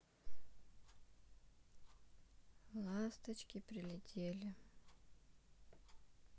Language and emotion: Russian, sad